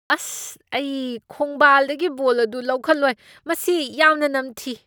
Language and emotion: Manipuri, disgusted